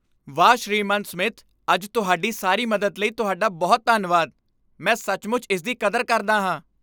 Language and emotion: Punjabi, happy